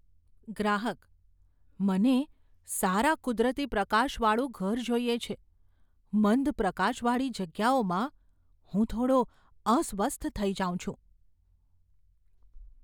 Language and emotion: Gujarati, fearful